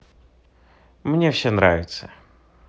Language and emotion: Russian, positive